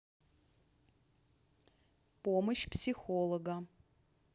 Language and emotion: Russian, neutral